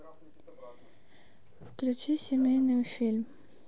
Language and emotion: Russian, neutral